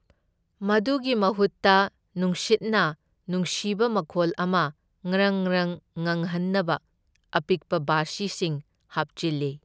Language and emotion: Manipuri, neutral